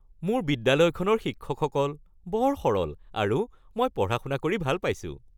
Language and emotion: Assamese, happy